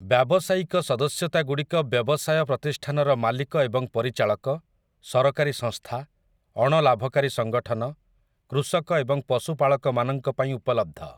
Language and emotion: Odia, neutral